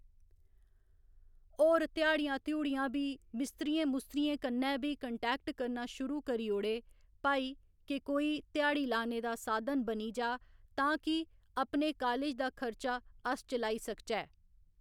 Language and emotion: Dogri, neutral